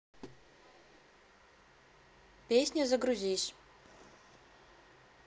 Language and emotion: Russian, neutral